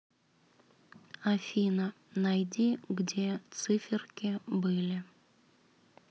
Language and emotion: Russian, sad